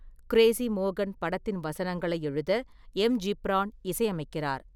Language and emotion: Tamil, neutral